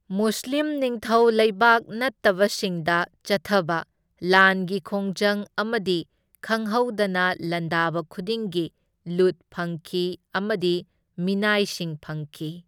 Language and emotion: Manipuri, neutral